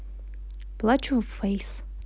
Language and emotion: Russian, sad